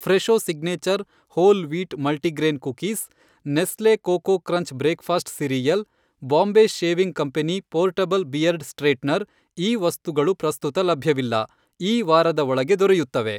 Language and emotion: Kannada, neutral